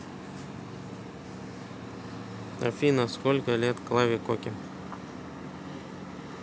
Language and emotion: Russian, neutral